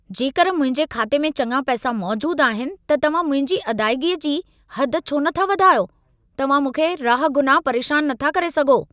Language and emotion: Sindhi, angry